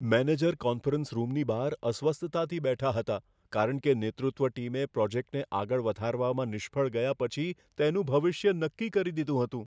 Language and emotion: Gujarati, fearful